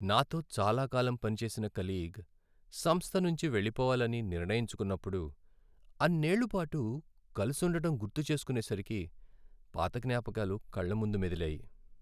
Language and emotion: Telugu, sad